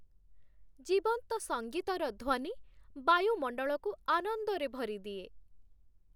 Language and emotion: Odia, happy